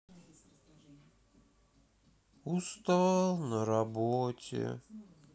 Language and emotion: Russian, sad